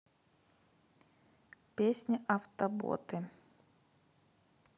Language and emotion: Russian, neutral